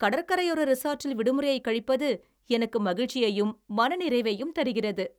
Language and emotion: Tamil, happy